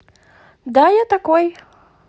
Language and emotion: Russian, positive